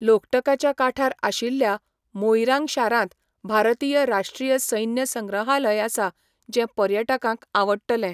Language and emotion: Goan Konkani, neutral